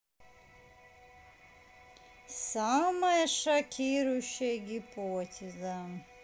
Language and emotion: Russian, neutral